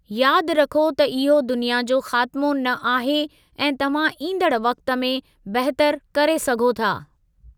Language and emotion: Sindhi, neutral